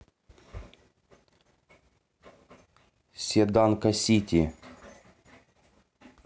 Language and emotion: Russian, neutral